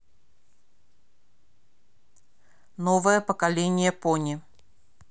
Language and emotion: Russian, neutral